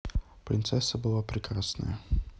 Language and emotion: Russian, neutral